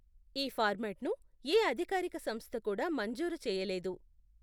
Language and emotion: Telugu, neutral